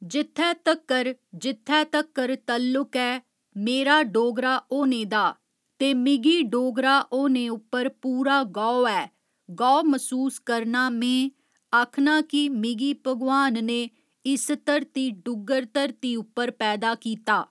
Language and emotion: Dogri, neutral